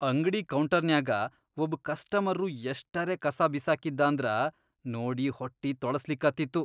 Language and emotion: Kannada, disgusted